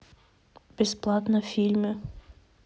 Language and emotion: Russian, neutral